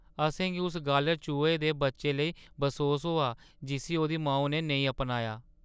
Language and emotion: Dogri, sad